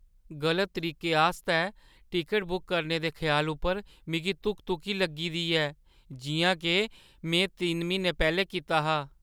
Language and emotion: Dogri, fearful